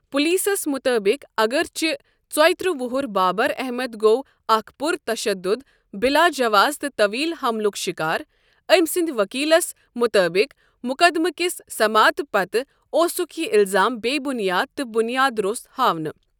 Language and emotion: Kashmiri, neutral